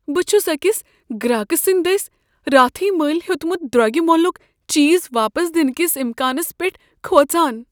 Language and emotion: Kashmiri, fearful